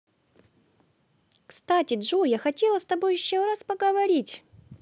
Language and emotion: Russian, positive